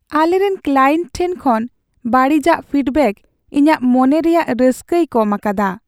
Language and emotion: Santali, sad